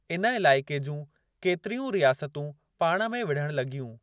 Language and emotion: Sindhi, neutral